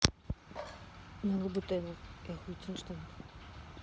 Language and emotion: Russian, neutral